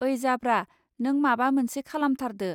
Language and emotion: Bodo, neutral